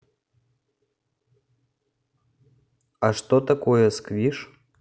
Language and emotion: Russian, neutral